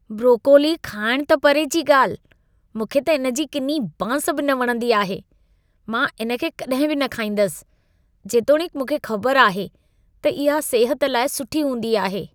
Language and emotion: Sindhi, disgusted